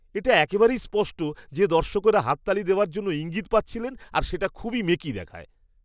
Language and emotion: Bengali, disgusted